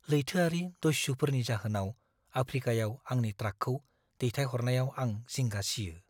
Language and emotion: Bodo, fearful